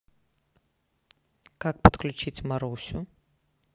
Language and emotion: Russian, neutral